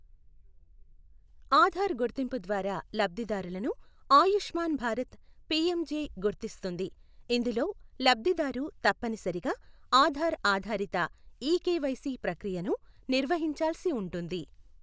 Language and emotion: Telugu, neutral